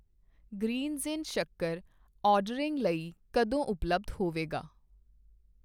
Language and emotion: Punjabi, neutral